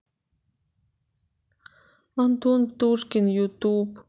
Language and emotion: Russian, sad